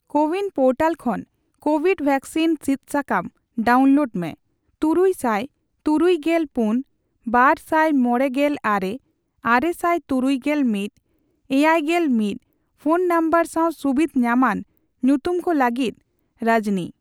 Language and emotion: Santali, neutral